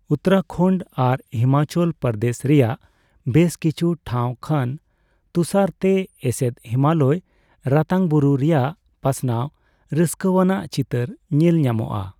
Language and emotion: Santali, neutral